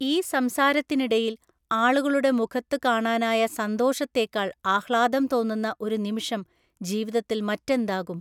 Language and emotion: Malayalam, neutral